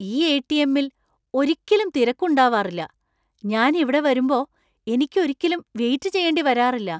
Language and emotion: Malayalam, surprised